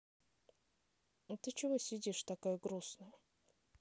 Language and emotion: Russian, neutral